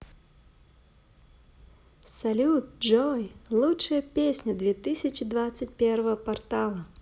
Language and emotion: Russian, positive